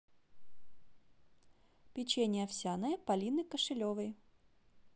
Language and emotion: Russian, neutral